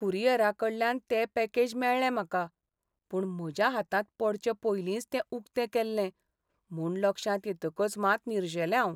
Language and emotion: Goan Konkani, sad